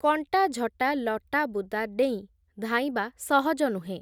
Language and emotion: Odia, neutral